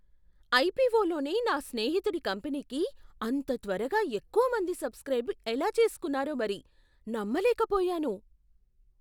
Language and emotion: Telugu, surprised